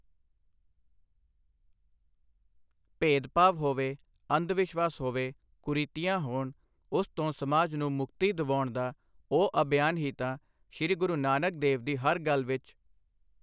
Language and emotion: Punjabi, neutral